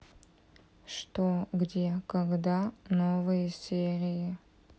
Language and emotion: Russian, neutral